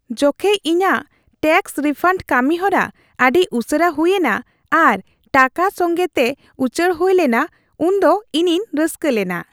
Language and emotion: Santali, happy